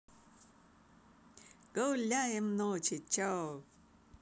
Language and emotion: Russian, positive